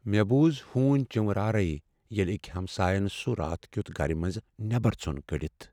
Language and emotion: Kashmiri, sad